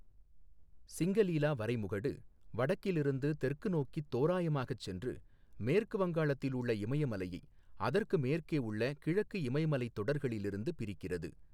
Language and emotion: Tamil, neutral